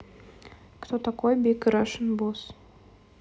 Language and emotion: Russian, neutral